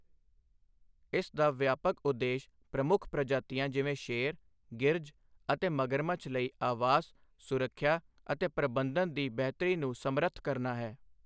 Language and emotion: Punjabi, neutral